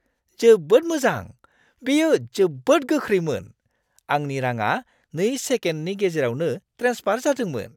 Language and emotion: Bodo, surprised